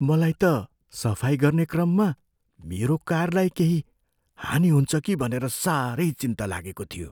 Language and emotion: Nepali, fearful